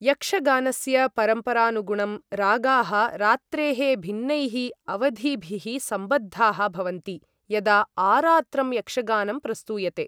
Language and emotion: Sanskrit, neutral